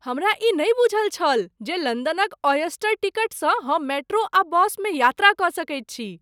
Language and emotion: Maithili, surprised